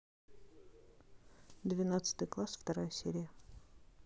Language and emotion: Russian, neutral